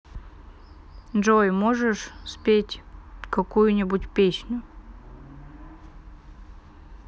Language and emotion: Russian, neutral